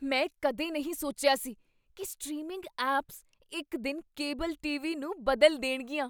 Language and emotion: Punjabi, surprised